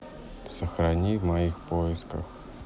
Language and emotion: Russian, neutral